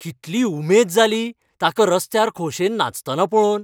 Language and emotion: Goan Konkani, happy